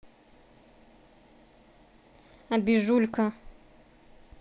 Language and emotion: Russian, neutral